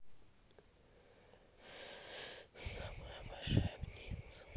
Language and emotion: Russian, sad